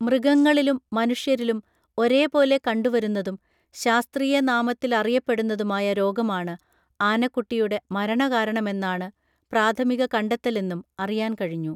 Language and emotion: Malayalam, neutral